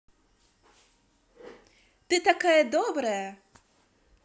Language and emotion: Russian, positive